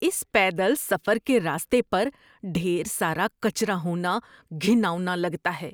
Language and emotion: Urdu, disgusted